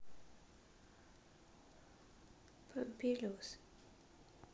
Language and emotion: Russian, sad